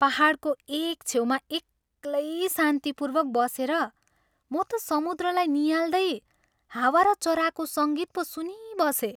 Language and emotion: Nepali, happy